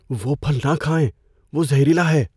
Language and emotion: Urdu, fearful